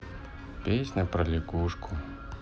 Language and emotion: Russian, sad